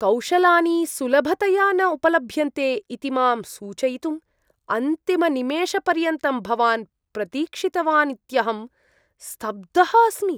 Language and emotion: Sanskrit, disgusted